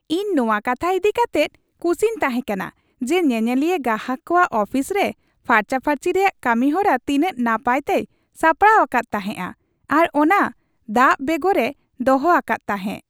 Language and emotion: Santali, happy